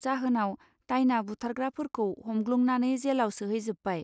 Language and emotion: Bodo, neutral